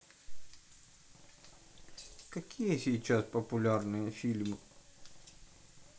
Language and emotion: Russian, neutral